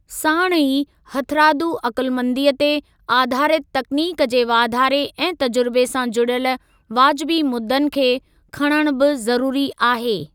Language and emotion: Sindhi, neutral